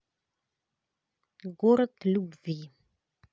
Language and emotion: Russian, neutral